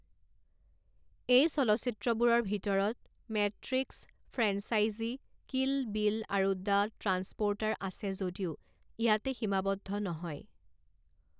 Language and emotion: Assamese, neutral